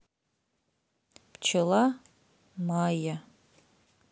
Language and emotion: Russian, neutral